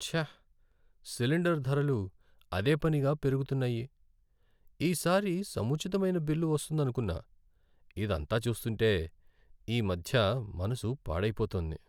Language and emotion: Telugu, sad